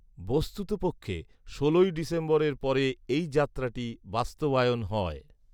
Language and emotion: Bengali, neutral